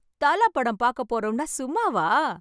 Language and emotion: Tamil, happy